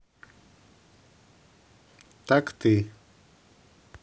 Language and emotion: Russian, neutral